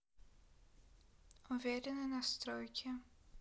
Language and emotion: Russian, neutral